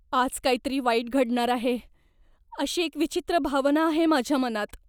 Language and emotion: Marathi, fearful